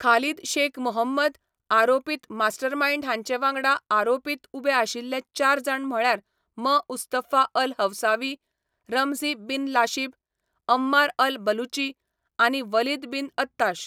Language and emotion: Goan Konkani, neutral